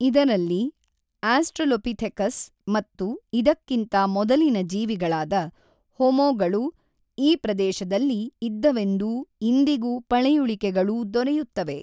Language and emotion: Kannada, neutral